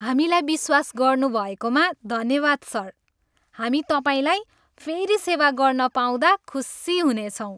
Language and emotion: Nepali, happy